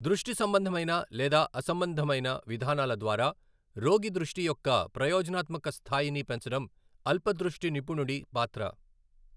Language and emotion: Telugu, neutral